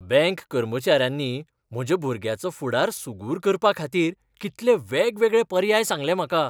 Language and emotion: Goan Konkani, happy